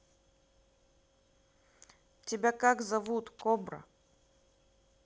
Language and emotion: Russian, neutral